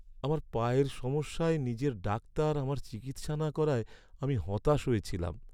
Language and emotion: Bengali, sad